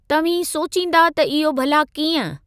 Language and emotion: Sindhi, neutral